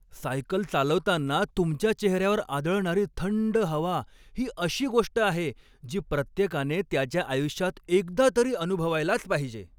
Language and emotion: Marathi, happy